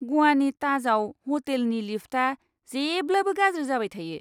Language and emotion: Bodo, disgusted